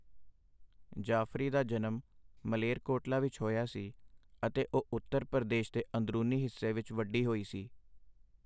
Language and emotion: Punjabi, neutral